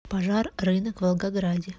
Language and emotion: Russian, neutral